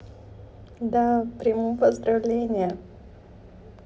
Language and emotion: Russian, sad